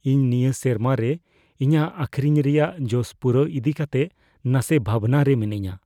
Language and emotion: Santali, fearful